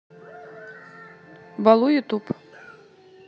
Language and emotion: Russian, neutral